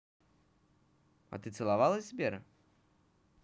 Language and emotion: Russian, positive